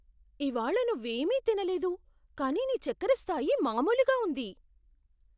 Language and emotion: Telugu, surprised